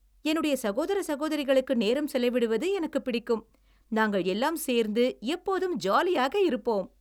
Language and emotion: Tamil, happy